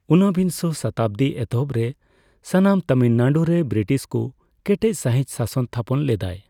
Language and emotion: Santali, neutral